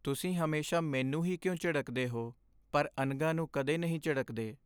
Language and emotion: Punjabi, sad